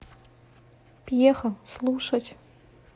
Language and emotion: Russian, neutral